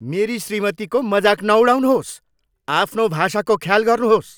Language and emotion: Nepali, angry